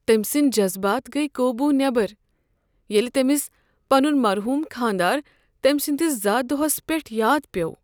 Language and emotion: Kashmiri, sad